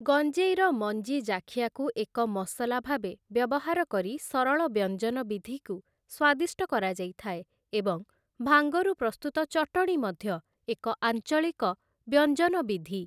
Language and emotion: Odia, neutral